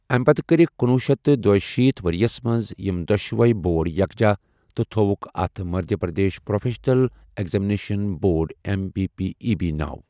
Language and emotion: Kashmiri, neutral